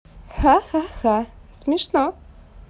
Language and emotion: Russian, positive